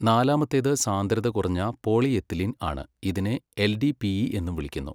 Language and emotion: Malayalam, neutral